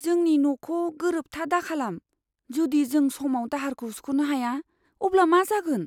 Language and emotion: Bodo, fearful